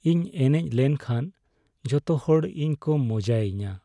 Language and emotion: Santali, sad